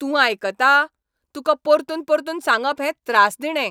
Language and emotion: Goan Konkani, angry